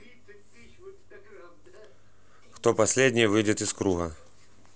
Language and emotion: Russian, neutral